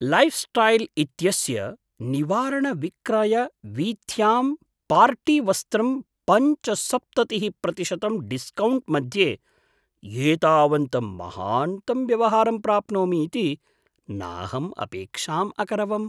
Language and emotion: Sanskrit, surprised